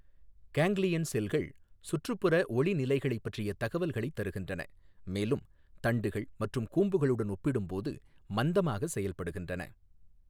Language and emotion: Tamil, neutral